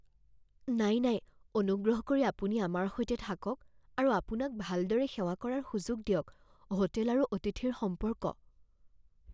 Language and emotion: Assamese, fearful